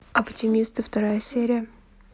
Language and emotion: Russian, neutral